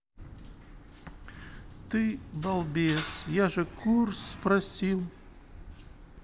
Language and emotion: Russian, sad